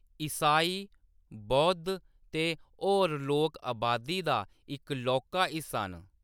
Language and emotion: Dogri, neutral